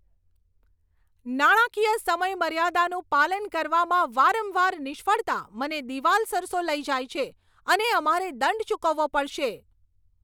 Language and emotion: Gujarati, angry